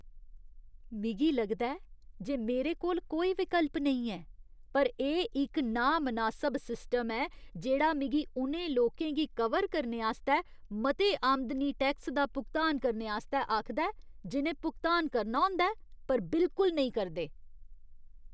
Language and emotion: Dogri, disgusted